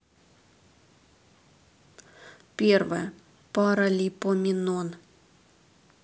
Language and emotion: Russian, neutral